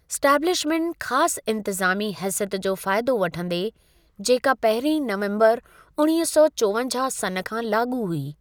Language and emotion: Sindhi, neutral